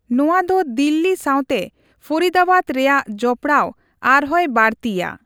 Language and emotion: Santali, neutral